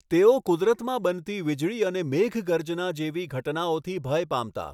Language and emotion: Gujarati, neutral